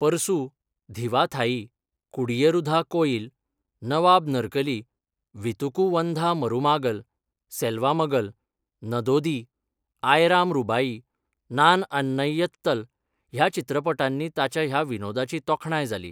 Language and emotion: Goan Konkani, neutral